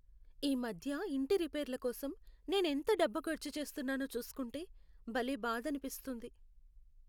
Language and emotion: Telugu, sad